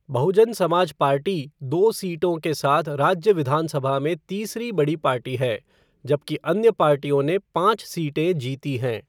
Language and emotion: Hindi, neutral